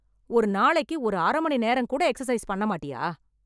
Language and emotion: Tamil, angry